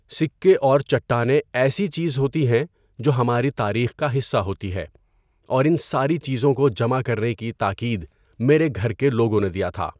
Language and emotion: Urdu, neutral